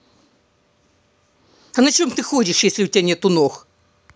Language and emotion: Russian, angry